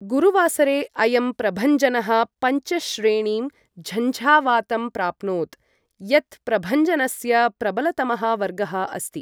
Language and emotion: Sanskrit, neutral